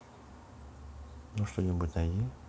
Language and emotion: Russian, neutral